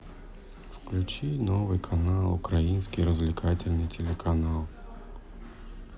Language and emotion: Russian, sad